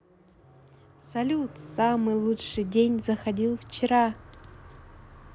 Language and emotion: Russian, positive